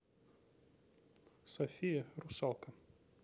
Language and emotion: Russian, neutral